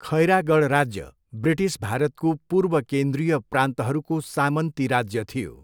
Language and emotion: Nepali, neutral